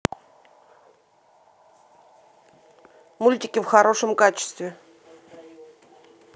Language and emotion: Russian, neutral